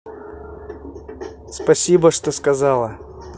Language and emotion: Russian, positive